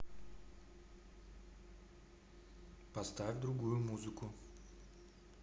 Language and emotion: Russian, neutral